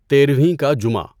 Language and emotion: Urdu, neutral